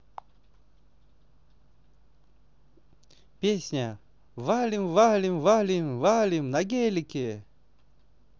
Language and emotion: Russian, positive